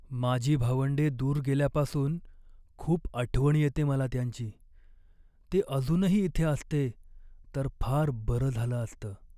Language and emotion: Marathi, sad